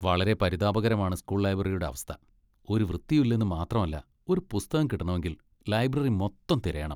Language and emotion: Malayalam, disgusted